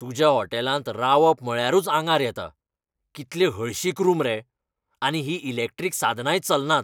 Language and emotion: Goan Konkani, angry